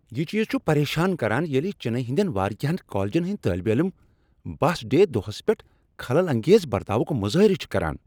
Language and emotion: Kashmiri, angry